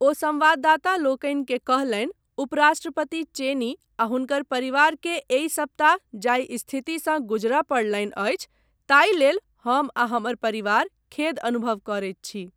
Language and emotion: Maithili, neutral